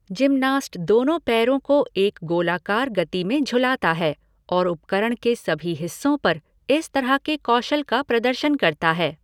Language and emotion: Hindi, neutral